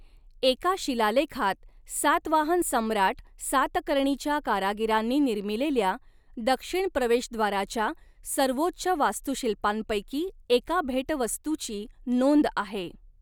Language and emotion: Marathi, neutral